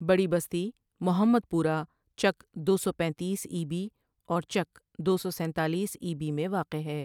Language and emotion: Urdu, neutral